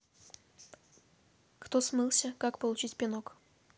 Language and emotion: Russian, neutral